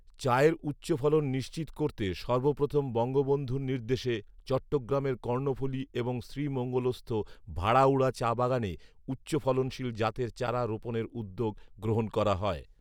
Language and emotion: Bengali, neutral